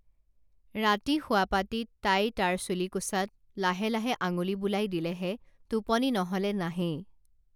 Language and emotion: Assamese, neutral